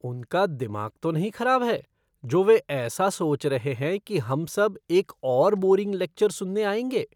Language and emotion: Hindi, disgusted